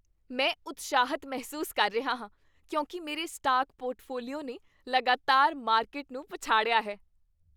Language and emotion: Punjabi, happy